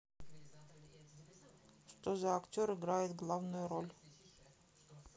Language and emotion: Russian, neutral